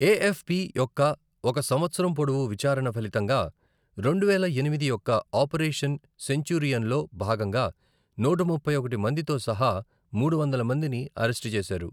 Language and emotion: Telugu, neutral